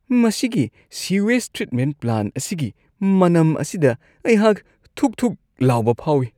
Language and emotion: Manipuri, disgusted